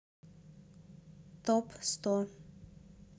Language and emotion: Russian, sad